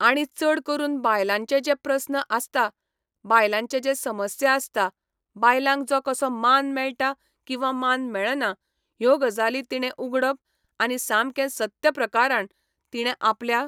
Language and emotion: Goan Konkani, neutral